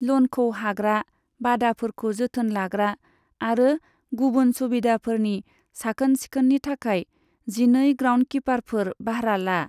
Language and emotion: Bodo, neutral